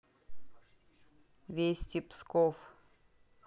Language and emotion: Russian, neutral